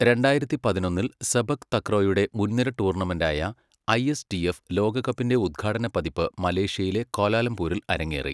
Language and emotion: Malayalam, neutral